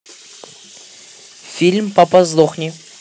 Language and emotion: Russian, neutral